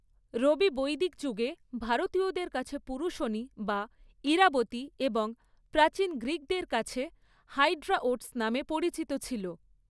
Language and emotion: Bengali, neutral